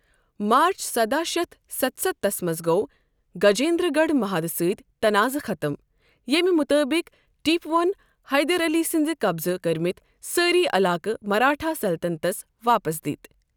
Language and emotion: Kashmiri, neutral